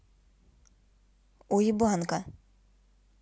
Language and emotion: Russian, neutral